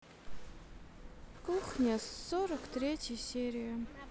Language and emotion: Russian, sad